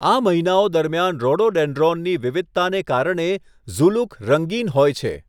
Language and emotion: Gujarati, neutral